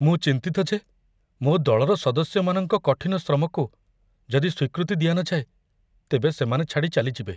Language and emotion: Odia, fearful